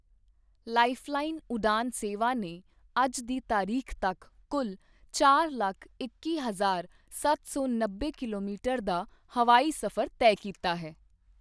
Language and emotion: Punjabi, neutral